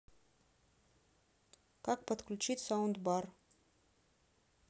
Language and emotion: Russian, neutral